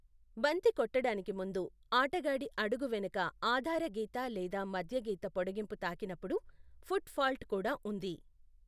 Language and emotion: Telugu, neutral